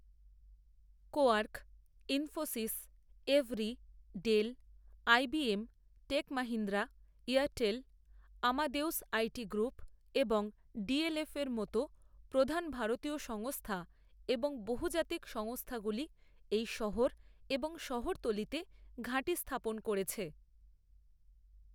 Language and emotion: Bengali, neutral